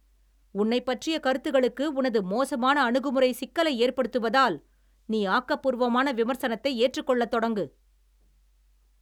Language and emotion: Tamil, angry